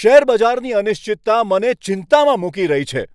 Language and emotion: Gujarati, angry